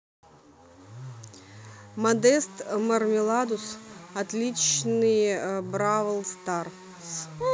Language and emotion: Russian, neutral